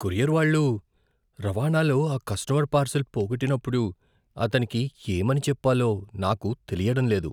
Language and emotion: Telugu, fearful